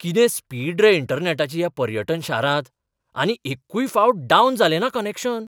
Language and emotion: Goan Konkani, surprised